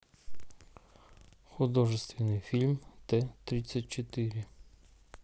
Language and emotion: Russian, neutral